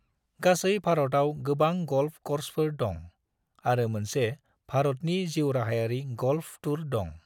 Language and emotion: Bodo, neutral